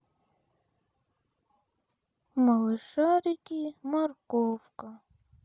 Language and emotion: Russian, sad